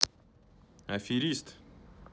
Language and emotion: Russian, neutral